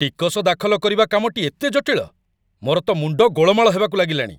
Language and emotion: Odia, angry